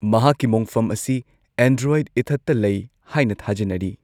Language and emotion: Manipuri, neutral